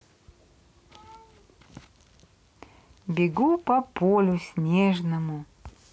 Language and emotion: Russian, positive